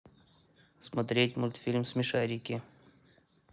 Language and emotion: Russian, neutral